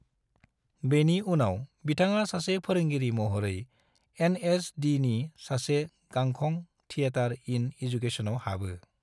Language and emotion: Bodo, neutral